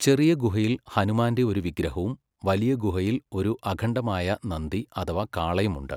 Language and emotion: Malayalam, neutral